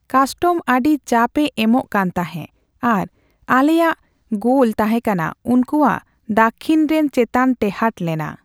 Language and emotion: Santali, neutral